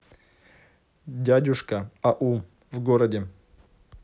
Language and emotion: Russian, neutral